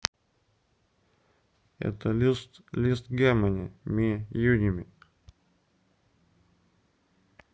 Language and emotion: Russian, neutral